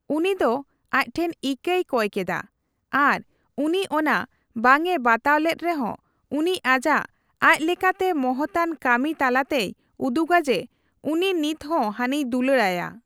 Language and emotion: Santali, neutral